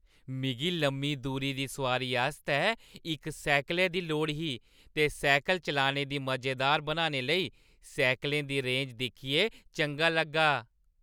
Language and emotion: Dogri, happy